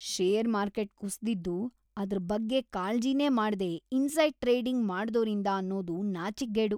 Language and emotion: Kannada, disgusted